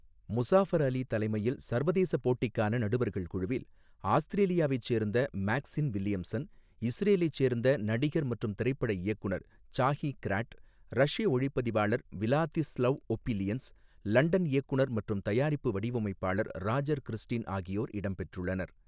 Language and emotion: Tamil, neutral